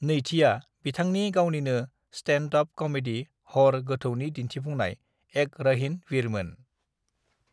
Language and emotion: Bodo, neutral